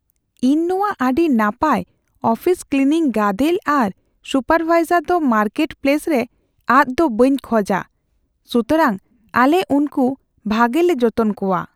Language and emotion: Santali, fearful